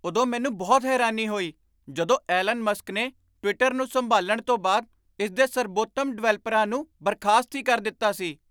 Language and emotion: Punjabi, surprised